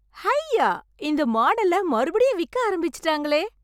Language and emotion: Tamil, happy